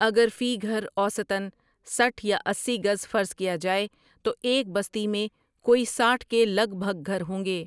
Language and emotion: Urdu, neutral